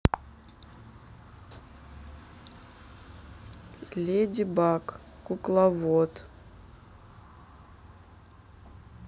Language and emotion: Russian, neutral